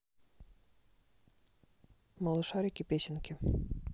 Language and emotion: Russian, neutral